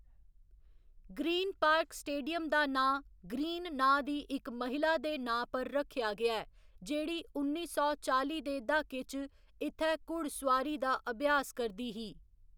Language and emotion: Dogri, neutral